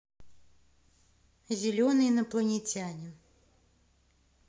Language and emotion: Russian, neutral